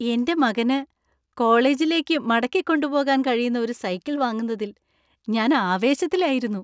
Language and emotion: Malayalam, happy